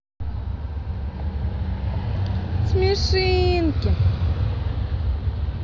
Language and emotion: Russian, positive